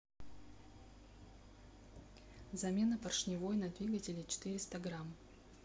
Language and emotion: Russian, neutral